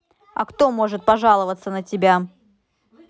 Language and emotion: Russian, angry